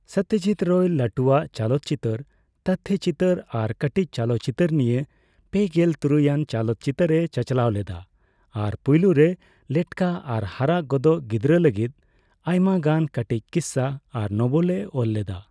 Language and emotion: Santali, neutral